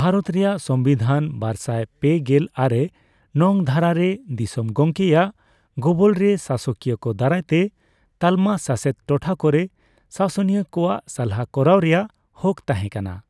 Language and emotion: Santali, neutral